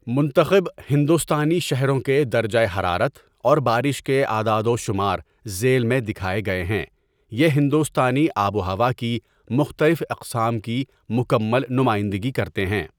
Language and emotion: Urdu, neutral